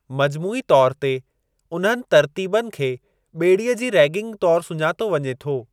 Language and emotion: Sindhi, neutral